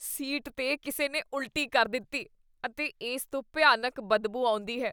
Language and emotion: Punjabi, disgusted